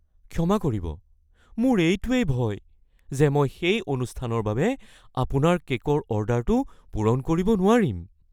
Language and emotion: Assamese, fearful